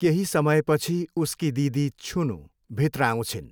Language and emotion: Nepali, neutral